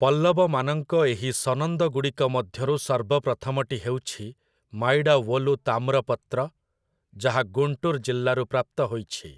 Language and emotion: Odia, neutral